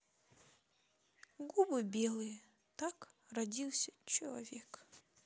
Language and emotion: Russian, sad